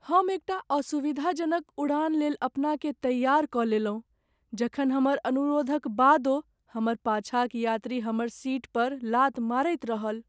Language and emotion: Maithili, sad